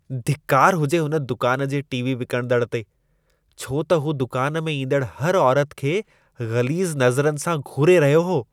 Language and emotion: Sindhi, disgusted